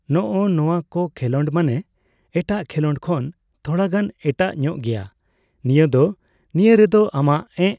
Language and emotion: Santali, neutral